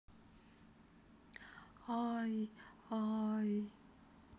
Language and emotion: Russian, sad